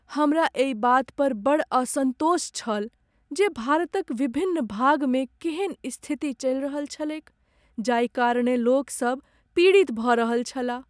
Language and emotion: Maithili, sad